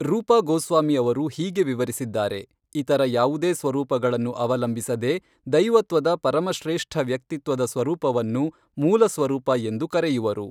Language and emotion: Kannada, neutral